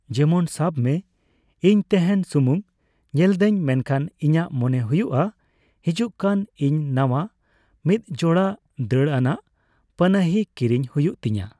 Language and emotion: Santali, neutral